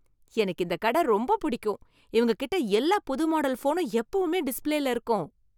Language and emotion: Tamil, happy